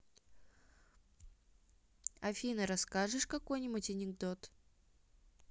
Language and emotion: Russian, neutral